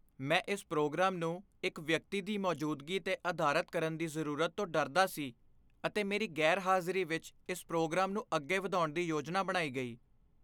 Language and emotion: Punjabi, fearful